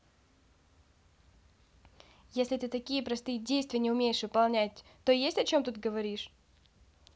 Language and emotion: Russian, angry